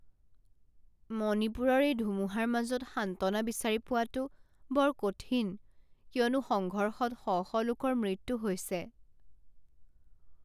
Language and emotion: Assamese, sad